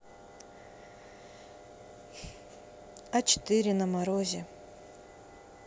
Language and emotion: Russian, neutral